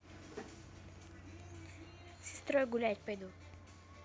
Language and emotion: Russian, neutral